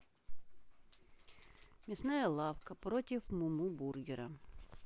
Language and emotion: Russian, neutral